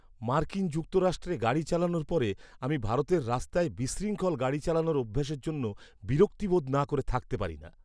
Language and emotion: Bengali, disgusted